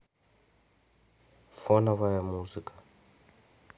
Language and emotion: Russian, neutral